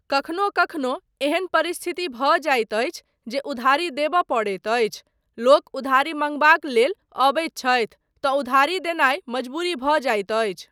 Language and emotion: Maithili, neutral